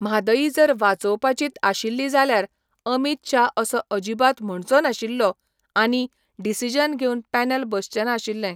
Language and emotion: Goan Konkani, neutral